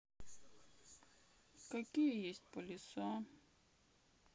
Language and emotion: Russian, sad